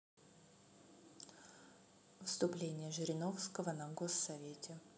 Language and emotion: Russian, neutral